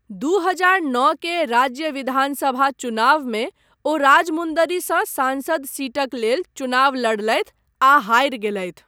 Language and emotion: Maithili, neutral